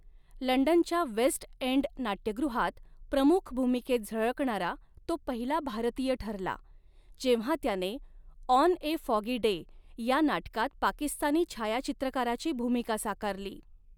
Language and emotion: Marathi, neutral